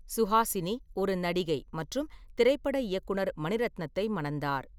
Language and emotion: Tamil, neutral